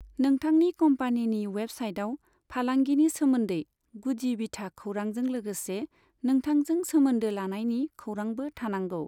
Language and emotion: Bodo, neutral